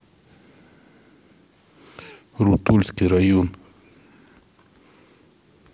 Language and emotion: Russian, neutral